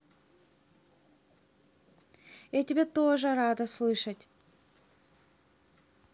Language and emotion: Russian, positive